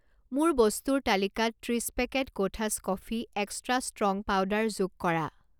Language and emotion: Assamese, neutral